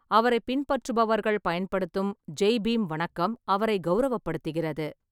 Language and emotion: Tamil, neutral